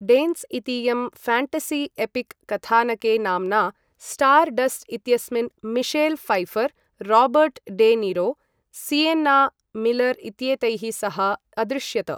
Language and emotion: Sanskrit, neutral